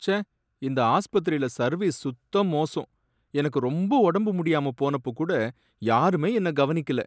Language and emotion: Tamil, sad